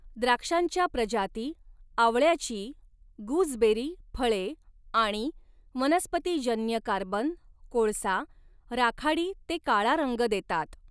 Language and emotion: Marathi, neutral